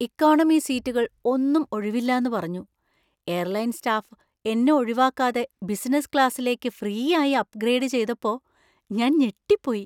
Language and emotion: Malayalam, surprised